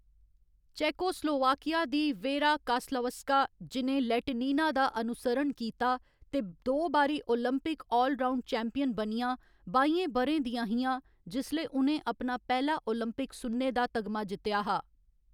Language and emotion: Dogri, neutral